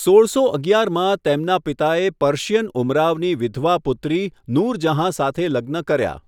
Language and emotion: Gujarati, neutral